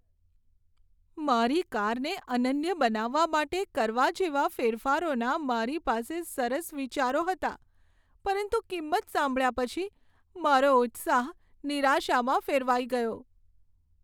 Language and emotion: Gujarati, sad